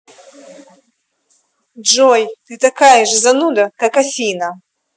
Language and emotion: Russian, angry